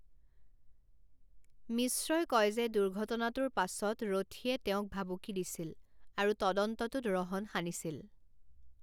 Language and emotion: Assamese, neutral